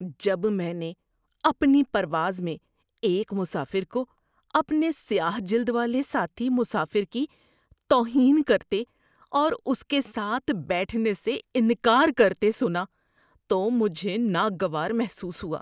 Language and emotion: Urdu, disgusted